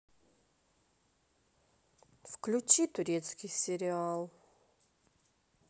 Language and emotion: Russian, sad